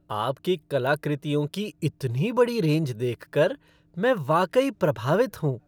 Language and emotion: Hindi, happy